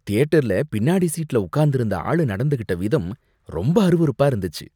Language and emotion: Tamil, disgusted